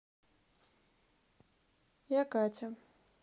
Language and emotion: Russian, neutral